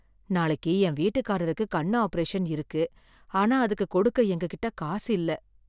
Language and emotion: Tamil, sad